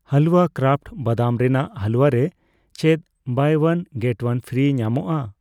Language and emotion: Santali, neutral